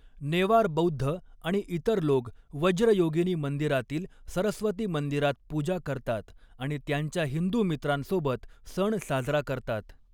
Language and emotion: Marathi, neutral